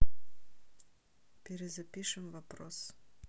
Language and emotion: Russian, neutral